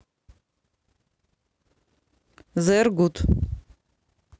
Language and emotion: Russian, neutral